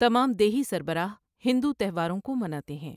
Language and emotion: Urdu, neutral